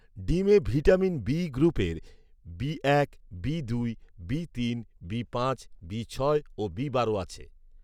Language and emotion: Bengali, neutral